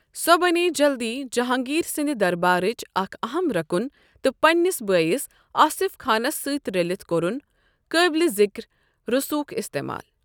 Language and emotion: Kashmiri, neutral